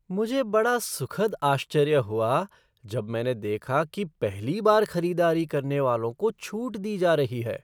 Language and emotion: Hindi, surprised